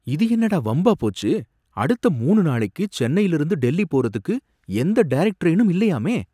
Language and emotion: Tamil, surprised